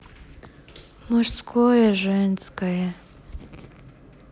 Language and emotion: Russian, sad